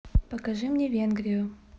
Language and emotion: Russian, neutral